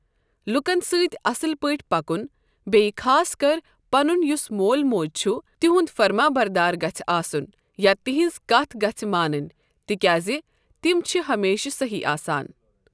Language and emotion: Kashmiri, neutral